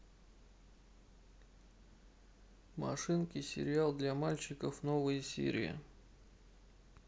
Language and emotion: Russian, neutral